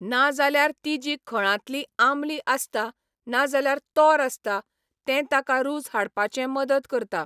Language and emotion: Goan Konkani, neutral